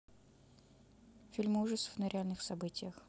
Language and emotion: Russian, neutral